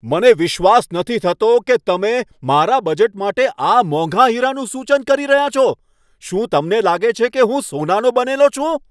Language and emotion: Gujarati, angry